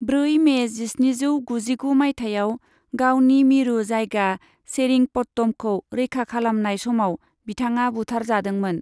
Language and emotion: Bodo, neutral